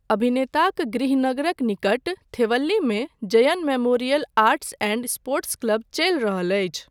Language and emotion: Maithili, neutral